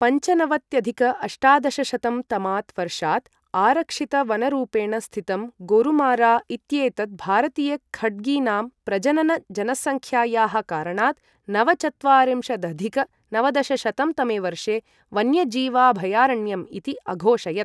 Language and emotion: Sanskrit, neutral